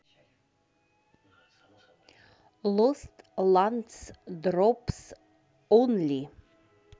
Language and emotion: Russian, neutral